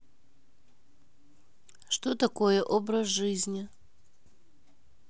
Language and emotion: Russian, neutral